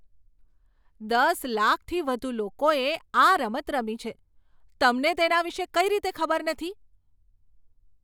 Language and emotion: Gujarati, surprised